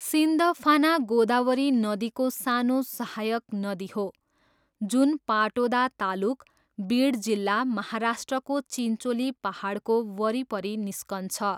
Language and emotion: Nepali, neutral